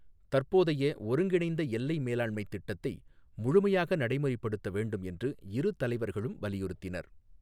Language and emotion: Tamil, neutral